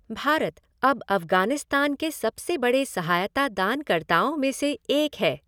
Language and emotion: Hindi, neutral